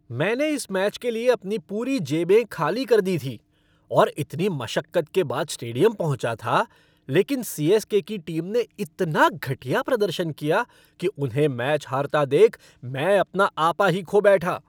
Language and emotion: Hindi, angry